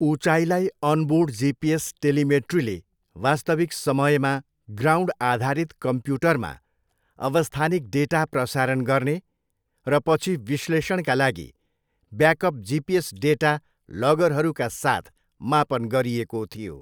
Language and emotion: Nepali, neutral